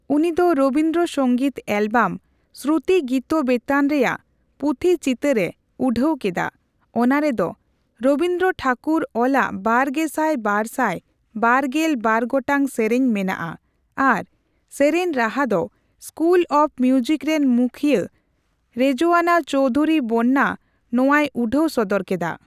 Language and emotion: Santali, neutral